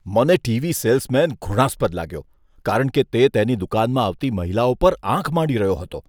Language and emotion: Gujarati, disgusted